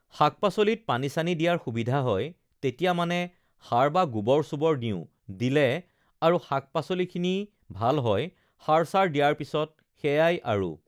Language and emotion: Assamese, neutral